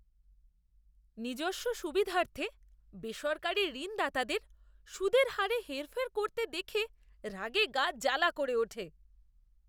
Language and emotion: Bengali, disgusted